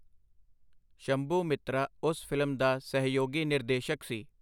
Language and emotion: Punjabi, neutral